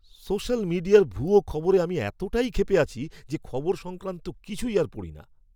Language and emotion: Bengali, angry